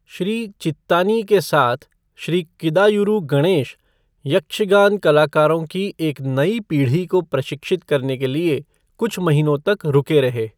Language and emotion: Hindi, neutral